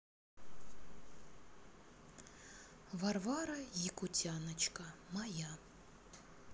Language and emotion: Russian, neutral